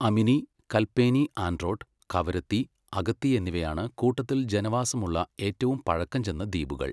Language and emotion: Malayalam, neutral